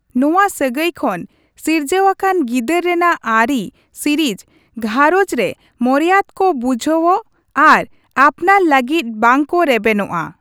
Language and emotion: Santali, neutral